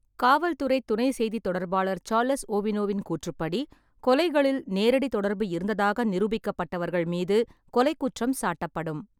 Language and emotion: Tamil, neutral